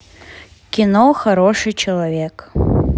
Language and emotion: Russian, neutral